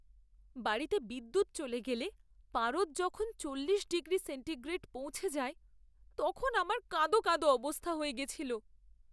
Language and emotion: Bengali, sad